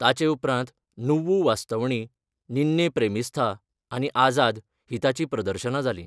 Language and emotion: Goan Konkani, neutral